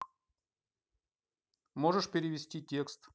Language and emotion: Russian, neutral